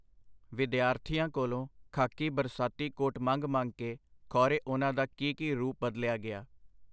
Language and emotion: Punjabi, neutral